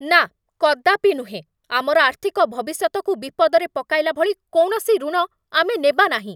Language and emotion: Odia, angry